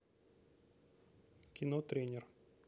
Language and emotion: Russian, neutral